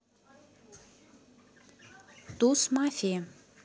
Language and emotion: Russian, neutral